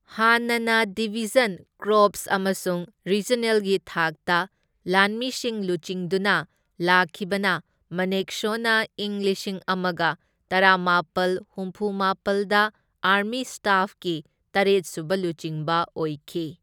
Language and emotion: Manipuri, neutral